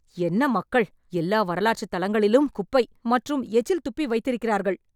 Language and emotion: Tamil, angry